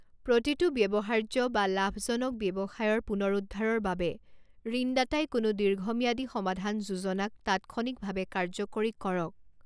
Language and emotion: Assamese, neutral